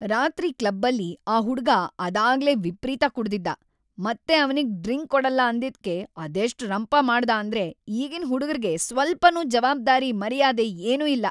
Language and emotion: Kannada, angry